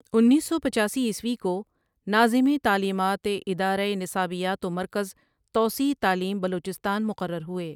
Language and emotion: Urdu, neutral